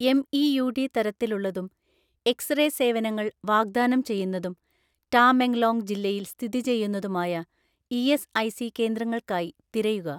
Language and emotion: Malayalam, neutral